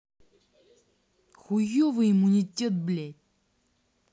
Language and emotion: Russian, angry